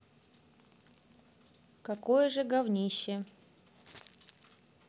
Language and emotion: Russian, neutral